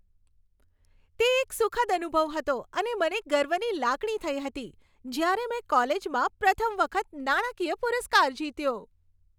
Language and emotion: Gujarati, happy